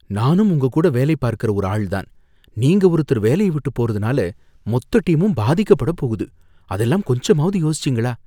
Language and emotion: Tamil, fearful